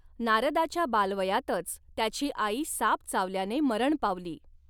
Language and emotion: Marathi, neutral